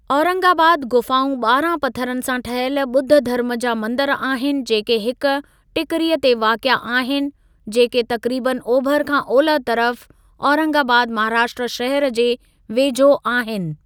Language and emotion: Sindhi, neutral